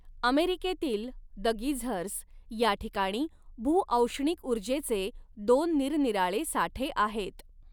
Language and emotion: Marathi, neutral